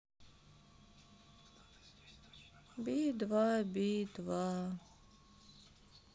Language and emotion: Russian, sad